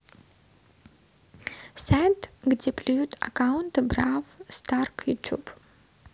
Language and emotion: Russian, neutral